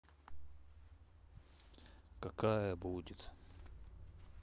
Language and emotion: Russian, sad